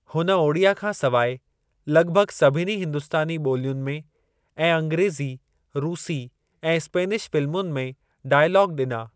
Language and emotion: Sindhi, neutral